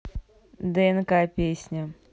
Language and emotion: Russian, neutral